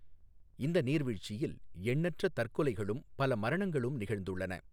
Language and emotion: Tamil, neutral